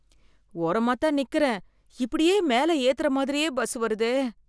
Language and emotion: Tamil, fearful